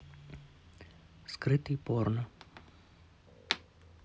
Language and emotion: Russian, neutral